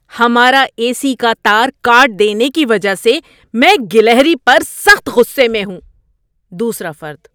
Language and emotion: Urdu, angry